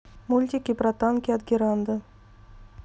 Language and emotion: Russian, neutral